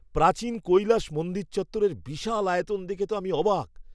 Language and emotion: Bengali, surprised